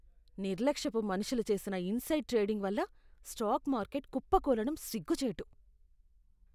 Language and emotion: Telugu, disgusted